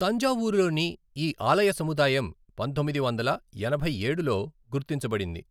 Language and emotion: Telugu, neutral